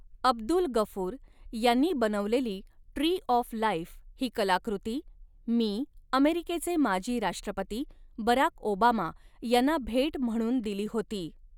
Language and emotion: Marathi, neutral